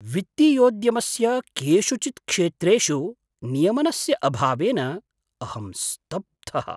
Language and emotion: Sanskrit, surprised